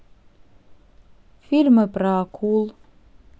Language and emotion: Russian, neutral